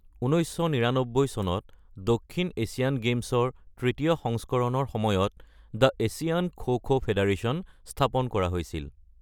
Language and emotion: Assamese, neutral